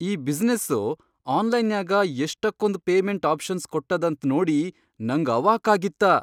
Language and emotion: Kannada, surprised